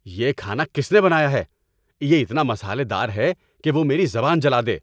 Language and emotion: Urdu, angry